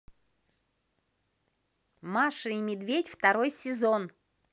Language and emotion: Russian, positive